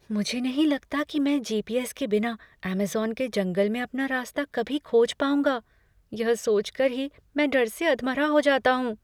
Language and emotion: Hindi, fearful